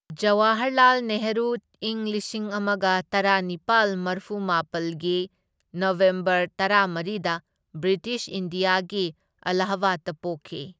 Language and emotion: Manipuri, neutral